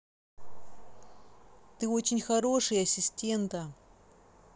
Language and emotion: Russian, positive